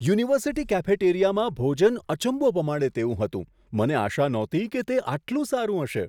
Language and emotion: Gujarati, surprised